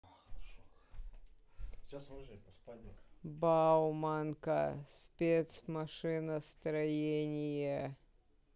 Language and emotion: Russian, neutral